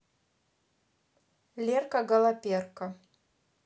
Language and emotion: Russian, neutral